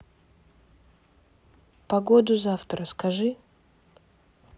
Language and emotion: Russian, neutral